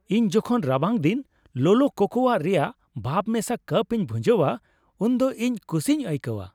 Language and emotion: Santali, happy